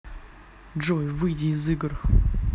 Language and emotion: Russian, neutral